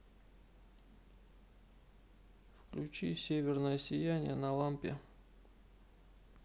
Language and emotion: Russian, neutral